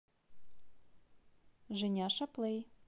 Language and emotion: Russian, positive